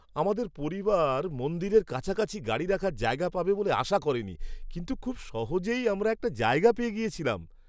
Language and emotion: Bengali, surprised